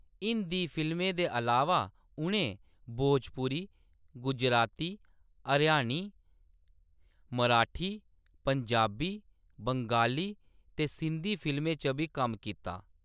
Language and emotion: Dogri, neutral